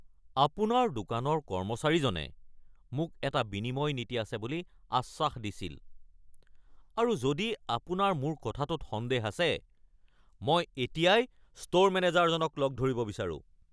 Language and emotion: Assamese, angry